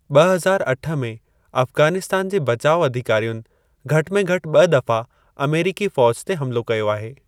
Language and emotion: Sindhi, neutral